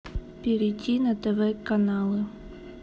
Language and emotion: Russian, neutral